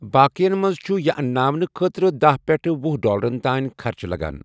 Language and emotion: Kashmiri, neutral